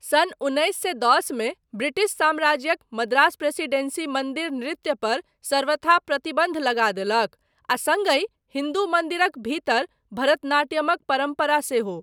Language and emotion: Maithili, neutral